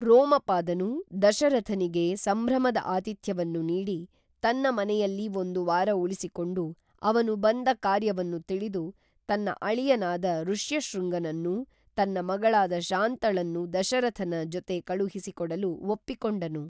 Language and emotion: Kannada, neutral